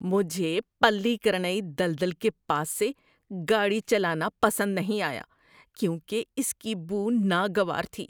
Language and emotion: Urdu, disgusted